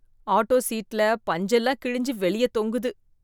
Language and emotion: Tamil, disgusted